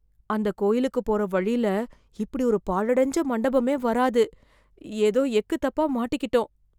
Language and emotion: Tamil, fearful